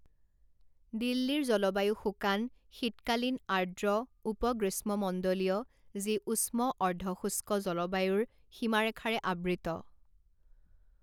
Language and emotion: Assamese, neutral